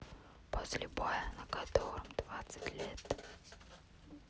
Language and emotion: Russian, neutral